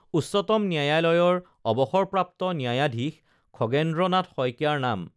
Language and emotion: Assamese, neutral